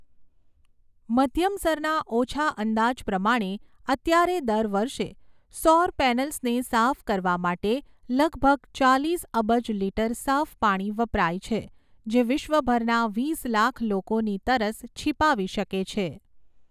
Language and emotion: Gujarati, neutral